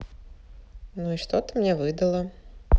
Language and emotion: Russian, neutral